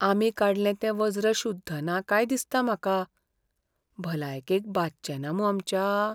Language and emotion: Goan Konkani, fearful